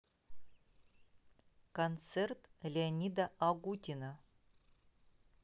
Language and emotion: Russian, neutral